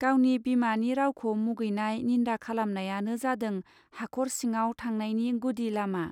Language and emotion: Bodo, neutral